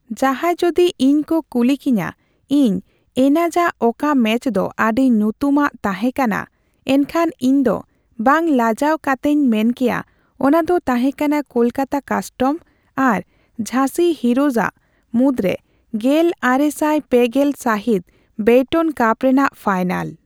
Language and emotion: Santali, neutral